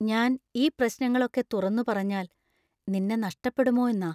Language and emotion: Malayalam, fearful